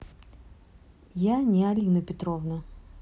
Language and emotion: Russian, neutral